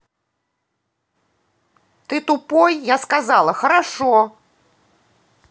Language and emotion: Russian, angry